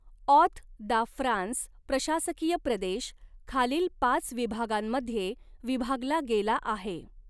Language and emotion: Marathi, neutral